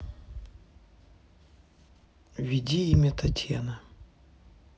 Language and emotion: Russian, neutral